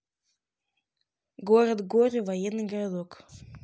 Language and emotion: Russian, neutral